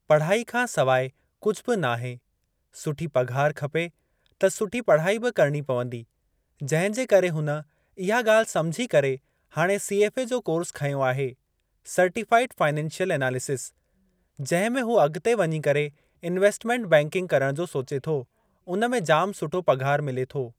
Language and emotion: Sindhi, neutral